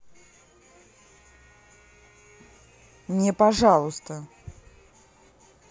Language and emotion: Russian, angry